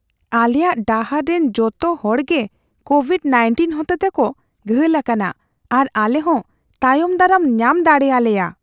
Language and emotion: Santali, fearful